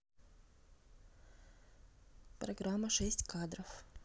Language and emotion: Russian, neutral